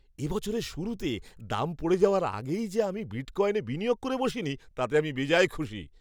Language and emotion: Bengali, happy